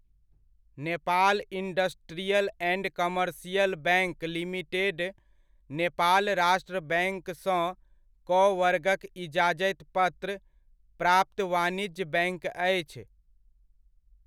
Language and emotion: Maithili, neutral